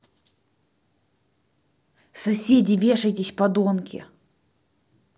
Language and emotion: Russian, angry